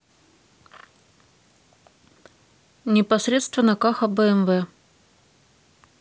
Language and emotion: Russian, neutral